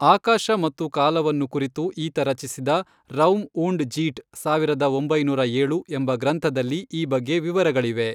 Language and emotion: Kannada, neutral